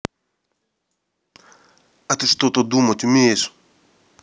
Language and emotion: Russian, angry